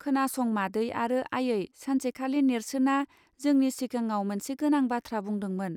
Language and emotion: Bodo, neutral